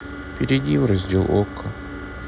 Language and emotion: Russian, sad